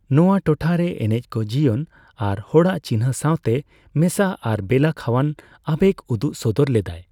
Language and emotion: Santali, neutral